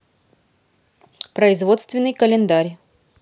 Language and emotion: Russian, neutral